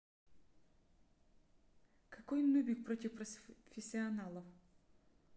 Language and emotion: Russian, neutral